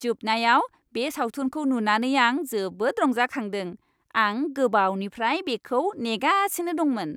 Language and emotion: Bodo, happy